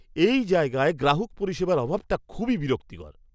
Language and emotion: Bengali, disgusted